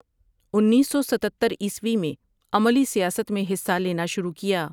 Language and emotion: Urdu, neutral